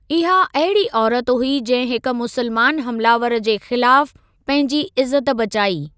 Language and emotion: Sindhi, neutral